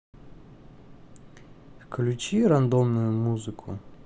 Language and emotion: Russian, neutral